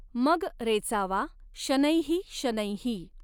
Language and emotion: Marathi, neutral